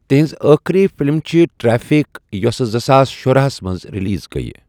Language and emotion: Kashmiri, neutral